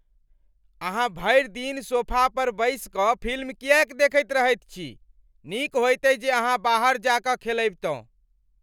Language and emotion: Maithili, angry